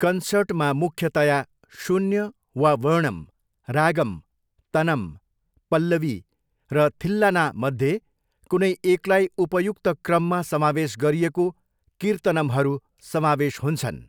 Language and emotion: Nepali, neutral